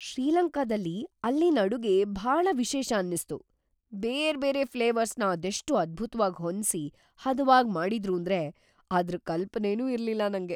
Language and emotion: Kannada, surprised